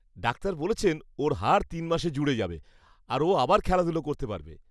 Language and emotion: Bengali, happy